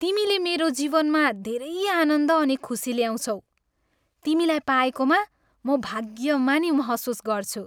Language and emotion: Nepali, happy